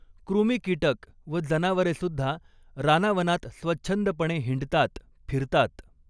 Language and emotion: Marathi, neutral